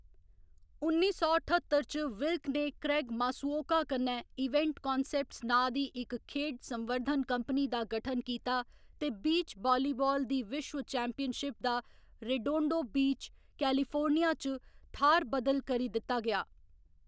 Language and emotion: Dogri, neutral